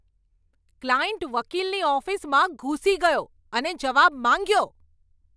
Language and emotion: Gujarati, angry